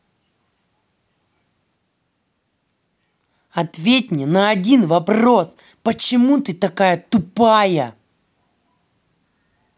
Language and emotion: Russian, angry